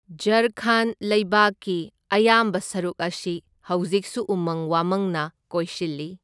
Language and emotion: Manipuri, neutral